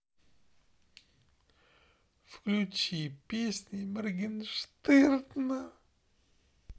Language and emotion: Russian, sad